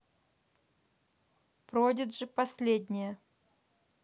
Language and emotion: Russian, neutral